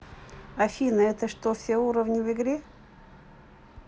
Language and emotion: Russian, neutral